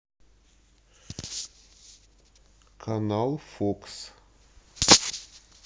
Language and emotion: Russian, neutral